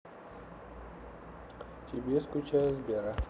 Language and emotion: Russian, neutral